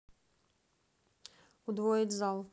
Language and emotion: Russian, neutral